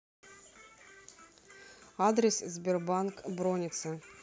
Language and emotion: Russian, neutral